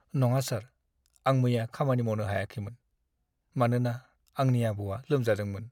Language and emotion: Bodo, sad